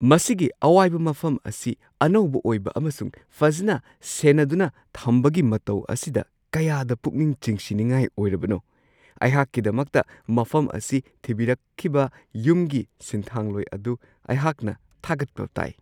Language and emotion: Manipuri, surprised